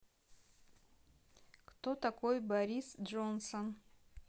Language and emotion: Russian, neutral